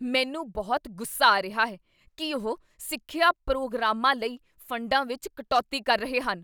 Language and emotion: Punjabi, angry